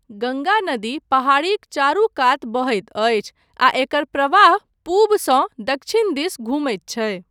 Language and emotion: Maithili, neutral